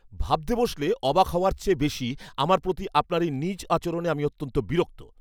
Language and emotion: Bengali, angry